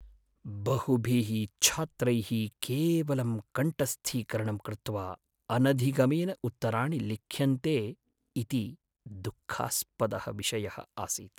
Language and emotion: Sanskrit, sad